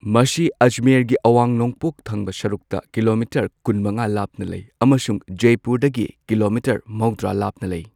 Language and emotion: Manipuri, neutral